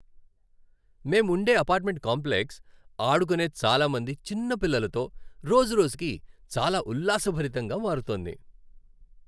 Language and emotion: Telugu, happy